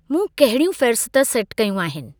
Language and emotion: Sindhi, neutral